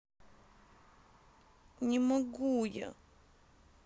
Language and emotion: Russian, sad